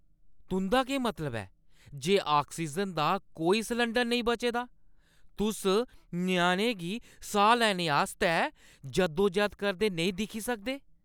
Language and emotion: Dogri, angry